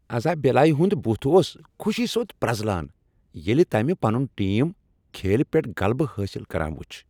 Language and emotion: Kashmiri, happy